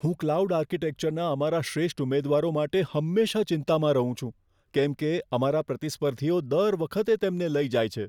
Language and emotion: Gujarati, fearful